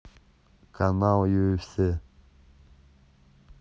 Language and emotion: Russian, neutral